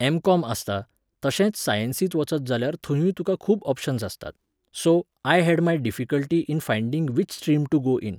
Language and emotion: Goan Konkani, neutral